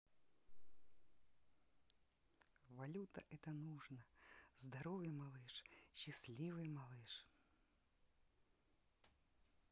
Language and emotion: Russian, positive